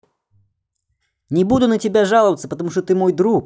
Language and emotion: Russian, positive